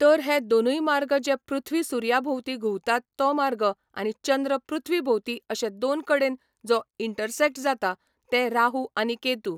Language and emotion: Goan Konkani, neutral